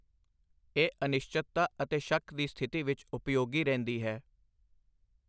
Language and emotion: Punjabi, neutral